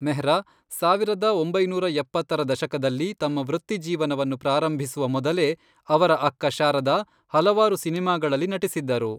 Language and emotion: Kannada, neutral